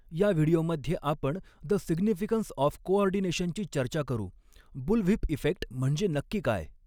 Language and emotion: Marathi, neutral